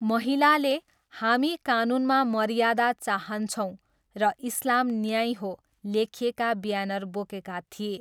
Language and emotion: Nepali, neutral